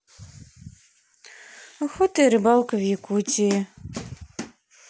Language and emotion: Russian, sad